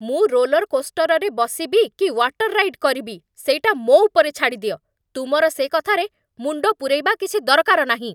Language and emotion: Odia, angry